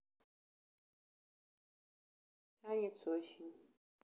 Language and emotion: Russian, sad